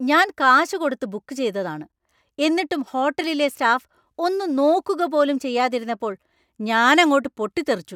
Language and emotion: Malayalam, angry